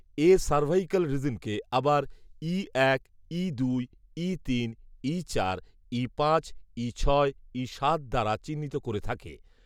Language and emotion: Bengali, neutral